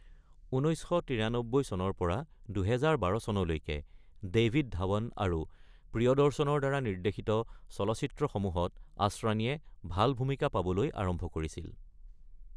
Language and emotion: Assamese, neutral